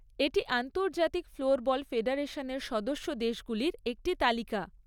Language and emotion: Bengali, neutral